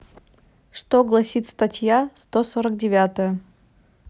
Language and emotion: Russian, neutral